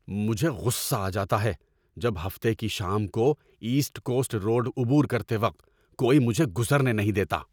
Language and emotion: Urdu, angry